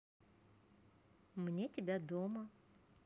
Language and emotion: Russian, positive